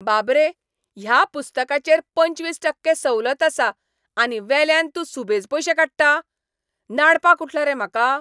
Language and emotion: Goan Konkani, angry